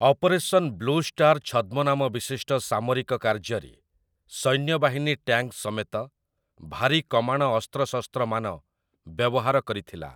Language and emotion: Odia, neutral